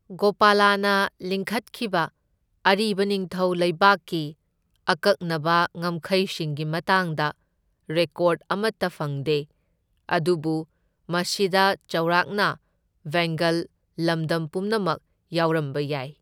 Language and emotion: Manipuri, neutral